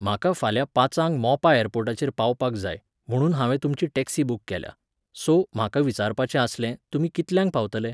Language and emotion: Goan Konkani, neutral